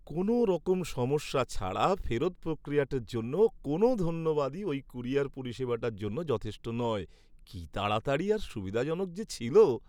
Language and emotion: Bengali, happy